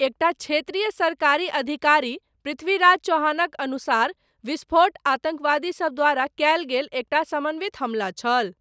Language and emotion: Maithili, neutral